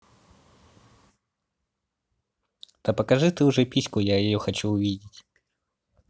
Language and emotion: Russian, positive